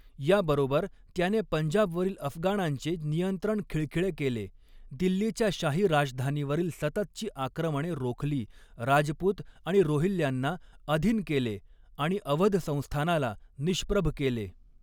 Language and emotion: Marathi, neutral